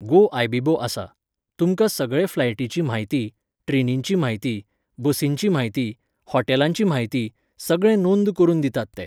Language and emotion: Goan Konkani, neutral